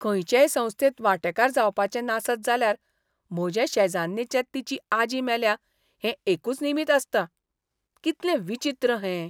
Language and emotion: Goan Konkani, disgusted